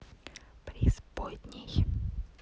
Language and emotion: Russian, neutral